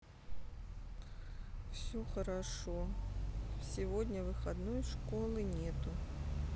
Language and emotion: Russian, sad